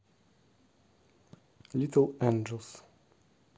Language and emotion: Russian, neutral